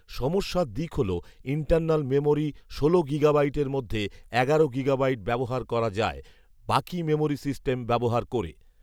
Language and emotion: Bengali, neutral